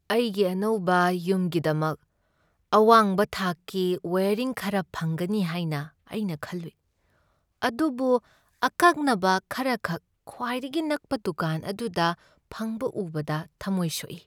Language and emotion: Manipuri, sad